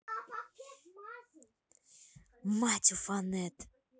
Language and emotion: Russian, angry